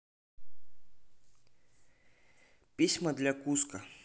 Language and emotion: Russian, neutral